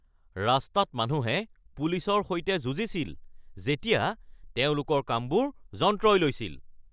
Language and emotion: Assamese, angry